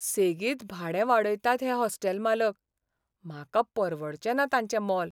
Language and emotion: Goan Konkani, sad